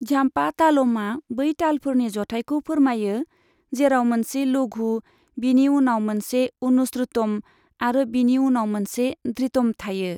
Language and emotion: Bodo, neutral